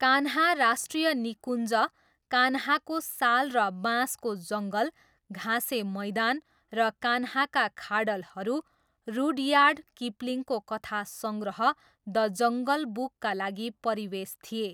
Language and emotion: Nepali, neutral